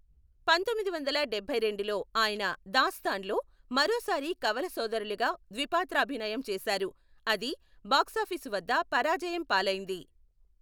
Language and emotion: Telugu, neutral